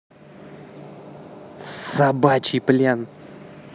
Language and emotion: Russian, angry